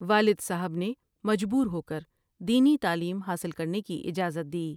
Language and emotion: Urdu, neutral